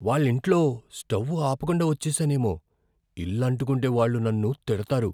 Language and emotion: Telugu, fearful